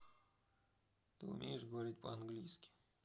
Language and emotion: Russian, neutral